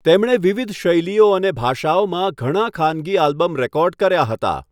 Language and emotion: Gujarati, neutral